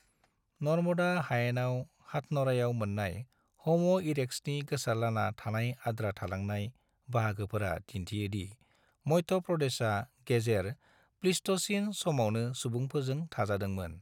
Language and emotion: Bodo, neutral